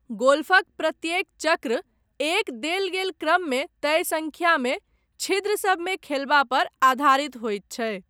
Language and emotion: Maithili, neutral